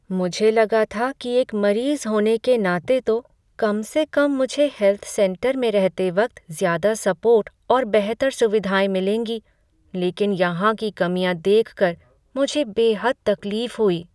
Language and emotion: Hindi, sad